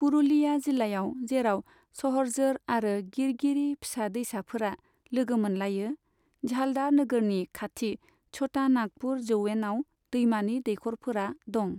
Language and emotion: Bodo, neutral